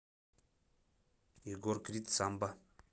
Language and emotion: Russian, neutral